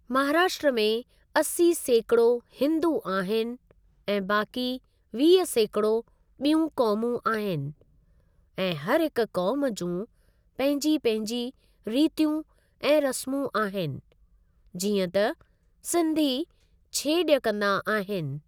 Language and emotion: Sindhi, neutral